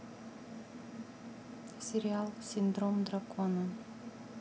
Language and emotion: Russian, neutral